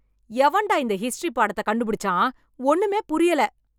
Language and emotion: Tamil, angry